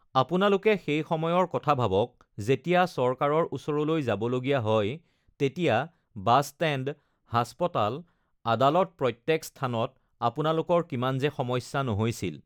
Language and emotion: Assamese, neutral